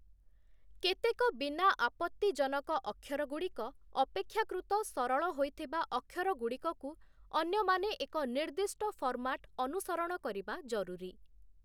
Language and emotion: Odia, neutral